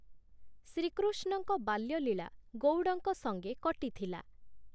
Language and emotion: Odia, neutral